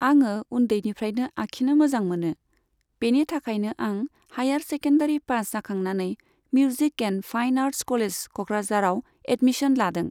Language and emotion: Bodo, neutral